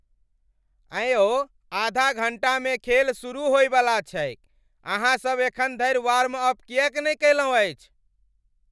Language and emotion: Maithili, angry